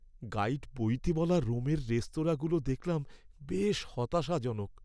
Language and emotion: Bengali, sad